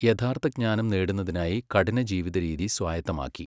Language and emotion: Malayalam, neutral